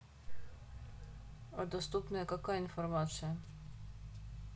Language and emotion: Russian, neutral